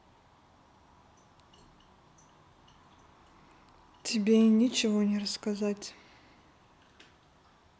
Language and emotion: Russian, neutral